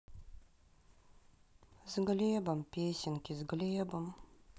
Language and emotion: Russian, sad